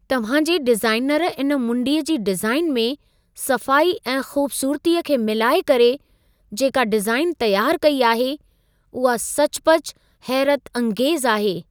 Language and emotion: Sindhi, surprised